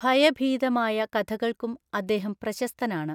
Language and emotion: Malayalam, neutral